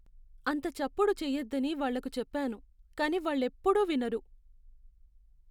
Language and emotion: Telugu, sad